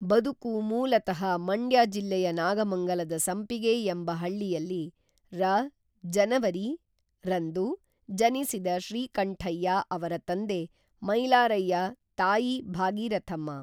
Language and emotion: Kannada, neutral